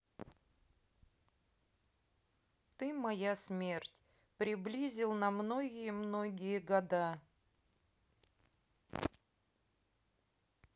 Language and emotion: Russian, neutral